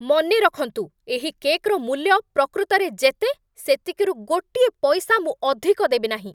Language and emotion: Odia, angry